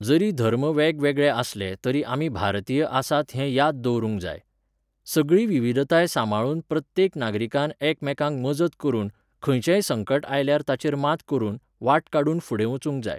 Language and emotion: Goan Konkani, neutral